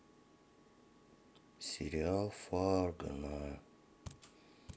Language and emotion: Russian, sad